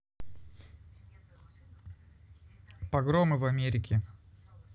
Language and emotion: Russian, neutral